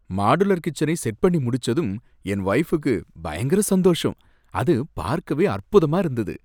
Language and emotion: Tamil, happy